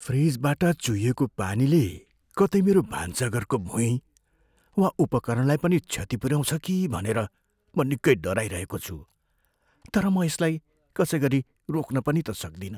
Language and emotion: Nepali, fearful